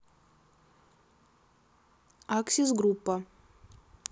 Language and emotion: Russian, neutral